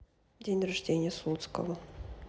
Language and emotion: Russian, neutral